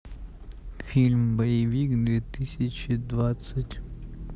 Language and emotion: Russian, neutral